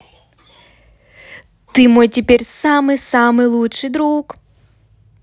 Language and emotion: Russian, positive